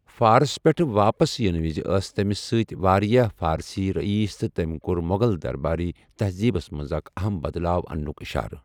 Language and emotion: Kashmiri, neutral